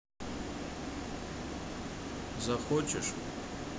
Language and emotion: Russian, neutral